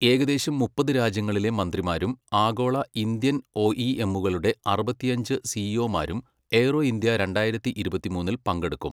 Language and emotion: Malayalam, neutral